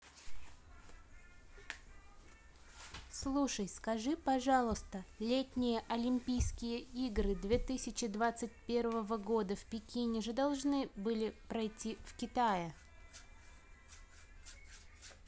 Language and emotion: Russian, neutral